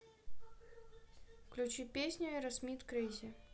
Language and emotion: Russian, neutral